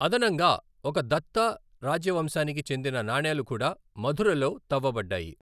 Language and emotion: Telugu, neutral